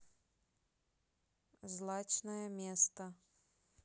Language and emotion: Russian, neutral